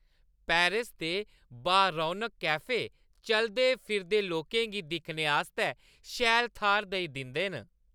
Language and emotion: Dogri, happy